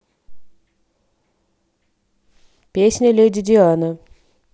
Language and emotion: Russian, neutral